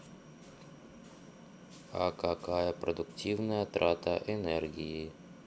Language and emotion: Russian, neutral